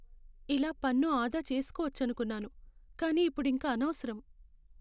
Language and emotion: Telugu, sad